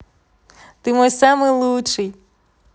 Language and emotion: Russian, positive